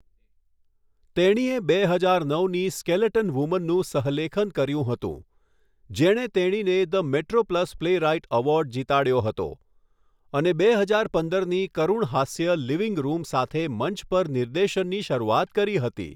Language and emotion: Gujarati, neutral